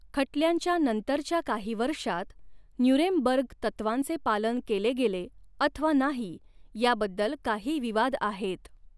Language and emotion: Marathi, neutral